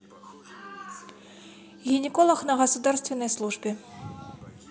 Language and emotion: Russian, neutral